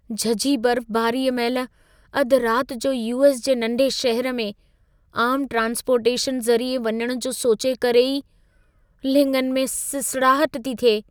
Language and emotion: Sindhi, fearful